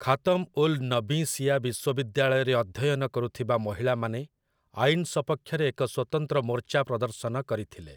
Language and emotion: Odia, neutral